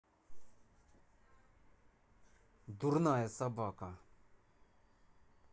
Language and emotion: Russian, angry